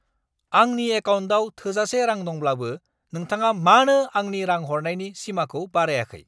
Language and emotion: Bodo, angry